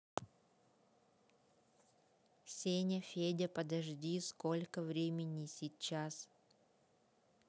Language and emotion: Russian, neutral